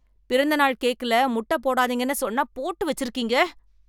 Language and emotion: Tamil, angry